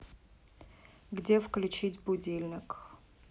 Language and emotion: Russian, neutral